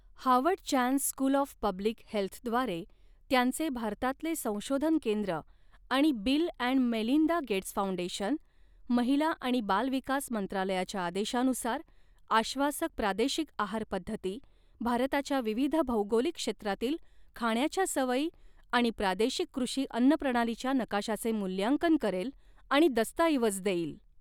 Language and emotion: Marathi, neutral